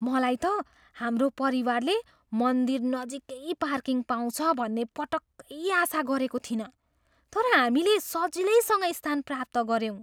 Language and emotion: Nepali, surprised